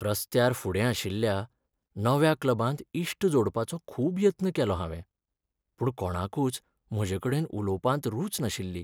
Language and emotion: Goan Konkani, sad